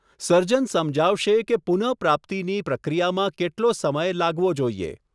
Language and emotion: Gujarati, neutral